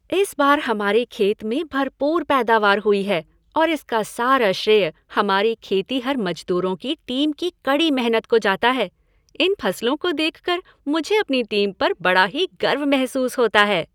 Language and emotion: Hindi, happy